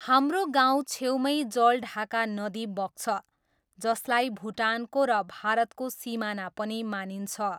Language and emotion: Nepali, neutral